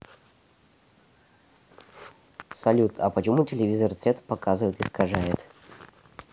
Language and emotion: Russian, neutral